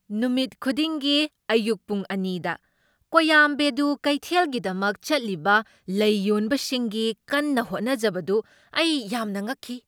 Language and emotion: Manipuri, surprised